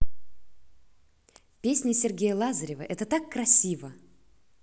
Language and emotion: Russian, positive